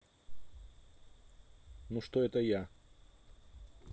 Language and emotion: Russian, neutral